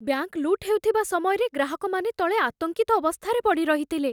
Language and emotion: Odia, fearful